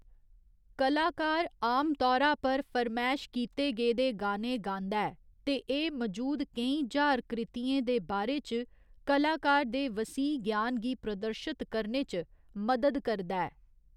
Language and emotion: Dogri, neutral